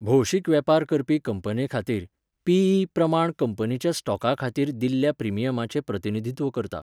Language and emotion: Goan Konkani, neutral